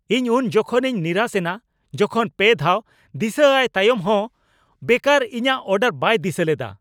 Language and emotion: Santali, angry